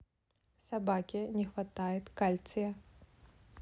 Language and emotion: Russian, neutral